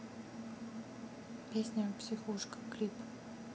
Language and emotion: Russian, neutral